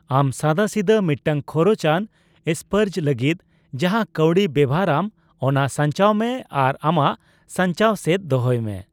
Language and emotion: Santali, neutral